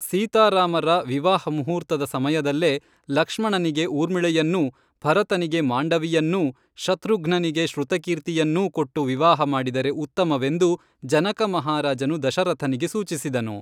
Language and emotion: Kannada, neutral